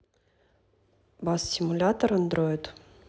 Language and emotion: Russian, neutral